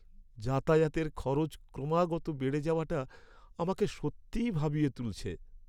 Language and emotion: Bengali, sad